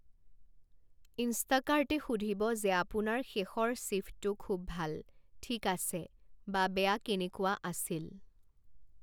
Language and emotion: Assamese, neutral